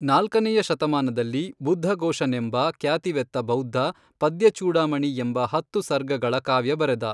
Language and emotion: Kannada, neutral